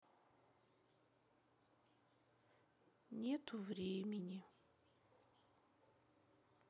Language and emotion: Russian, sad